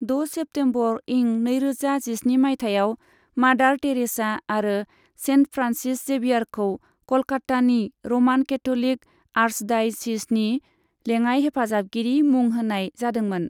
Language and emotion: Bodo, neutral